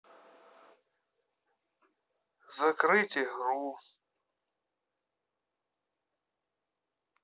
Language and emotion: Russian, sad